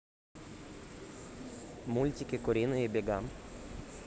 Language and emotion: Russian, neutral